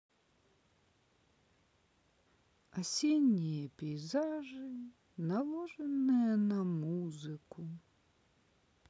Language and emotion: Russian, sad